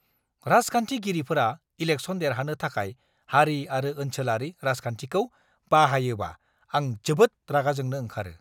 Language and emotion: Bodo, angry